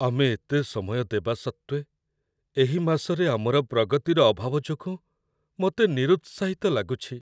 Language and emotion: Odia, sad